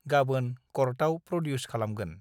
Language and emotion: Bodo, neutral